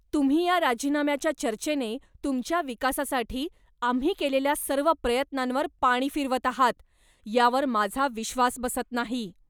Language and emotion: Marathi, angry